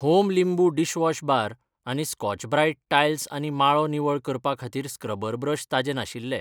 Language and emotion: Goan Konkani, neutral